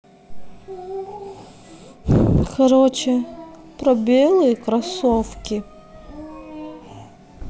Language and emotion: Russian, sad